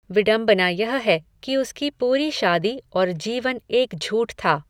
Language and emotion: Hindi, neutral